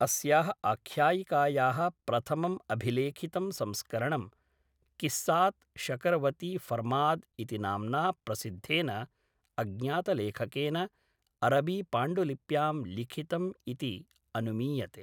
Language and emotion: Sanskrit, neutral